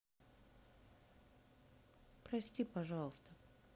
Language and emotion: Russian, sad